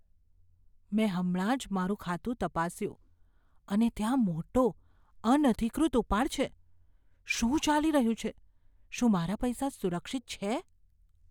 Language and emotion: Gujarati, fearful